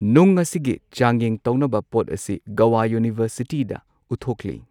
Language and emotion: Manipuri, neutral